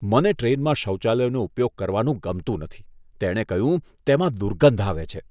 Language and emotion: Gujarati, disgusted